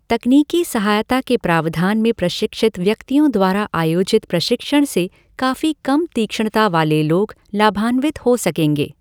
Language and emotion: Hindi, neutral